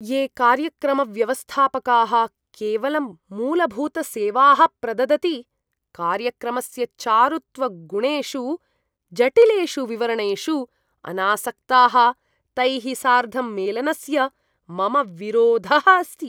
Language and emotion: Sanskrit, disgusted